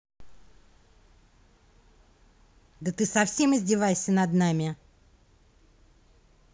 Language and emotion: Russian, angry